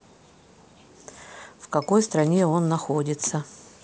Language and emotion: Russian, neutral